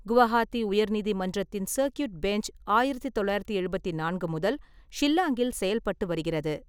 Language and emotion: Tamil, neutral